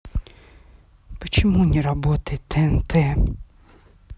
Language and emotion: Russian, angry